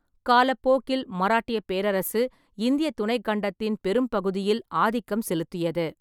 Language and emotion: Tamil, neutral